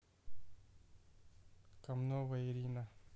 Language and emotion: Russian, neutral